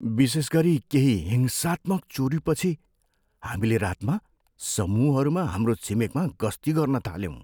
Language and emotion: Nepali, fearful